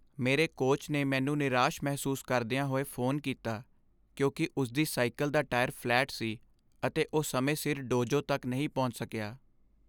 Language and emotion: Punjabi, sad